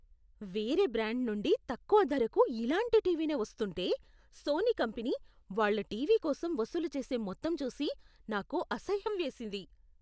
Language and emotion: Telugu, disgusted